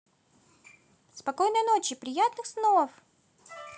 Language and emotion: Russian, positive